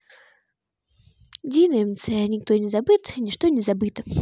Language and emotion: Russian, neutral